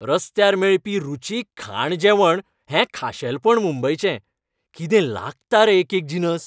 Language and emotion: Goan Konkani, happy